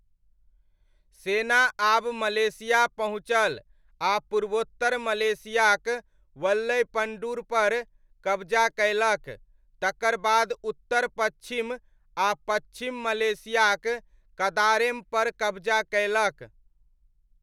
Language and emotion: Maithili, neutral